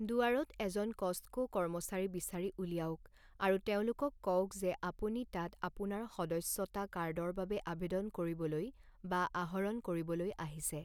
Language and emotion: Assamese, neutral